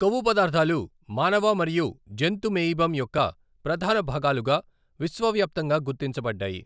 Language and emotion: Telugu, neutral